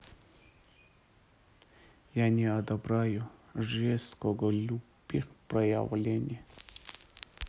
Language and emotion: Russian, neutral